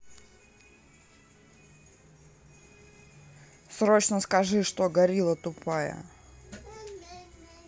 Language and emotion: Russian, angry